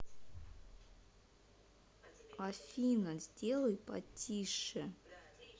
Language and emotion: Russian, angry